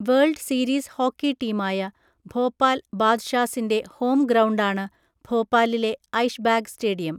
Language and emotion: Malayalam, neutral